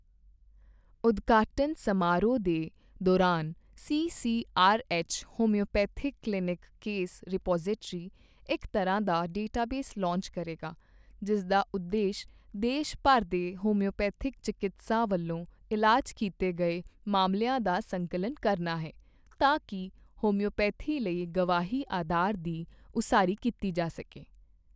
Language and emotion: Punjabi, neutral